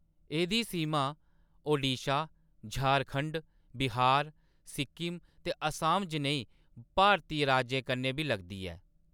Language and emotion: Dogri, neutral